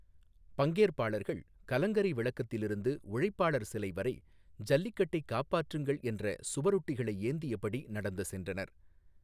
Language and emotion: Tamil, neutral